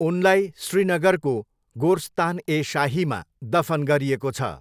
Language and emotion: Nepali, neutral